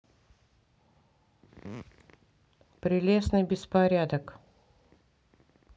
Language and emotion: Russian, neutral